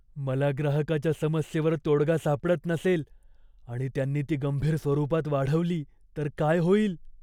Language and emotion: Marathi, fearful